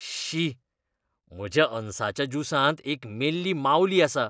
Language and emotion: Goan Konkani, disgusted